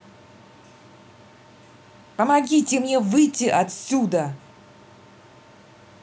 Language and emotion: Russian, angry